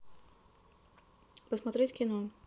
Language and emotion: Russian, neutral